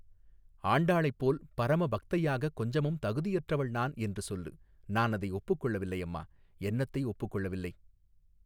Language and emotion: Tamil, neutral